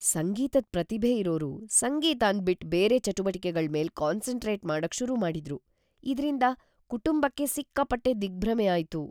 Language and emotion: Kannada, fearful